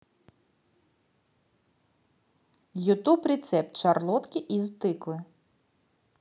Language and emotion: Russian, positive